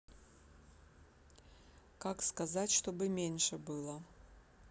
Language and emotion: Russian, neutral